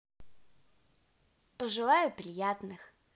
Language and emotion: Russian, positive